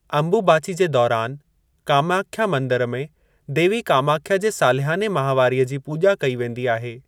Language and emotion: Sindhi, neutral